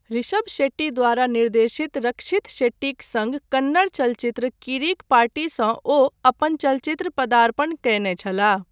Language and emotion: Maithili, neutral